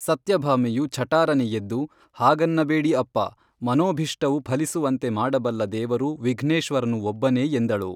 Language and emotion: Kannada, neutral